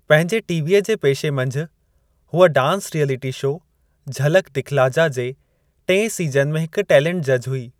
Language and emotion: Sindhi, neutral